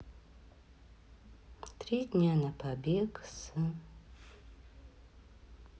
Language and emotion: Russian, sad